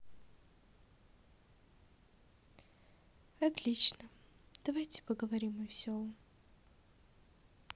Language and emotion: Russian, sad